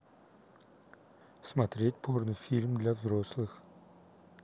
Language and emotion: Russian, neutral